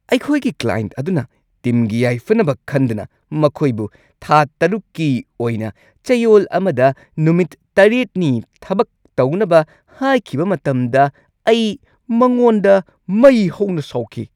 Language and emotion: Manipuri, angry